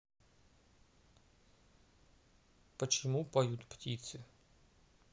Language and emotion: Russian, neutral